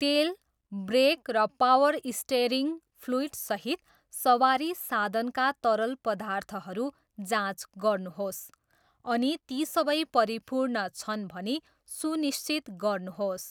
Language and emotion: Nepali, neutral